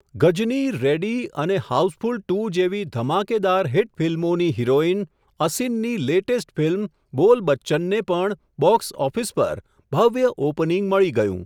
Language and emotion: Gujarati, neutral